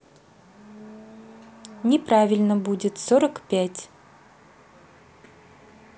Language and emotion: Russian, neutral